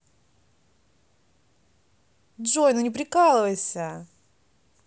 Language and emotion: Russian, positive